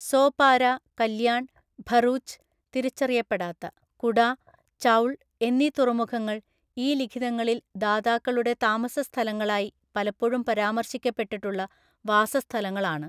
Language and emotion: Malayalam, neutral